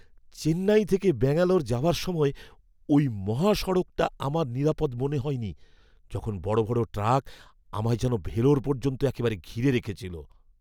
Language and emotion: Bengali, fearful